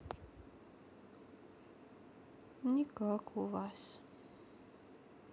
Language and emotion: Russian, sad